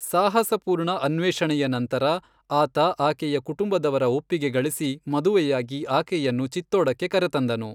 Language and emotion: Kannada, neutral